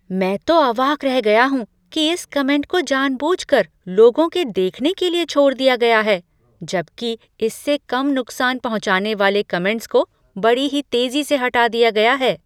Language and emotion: Hindi, surprised